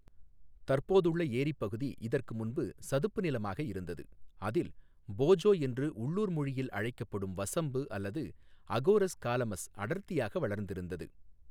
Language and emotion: Tamil, neutral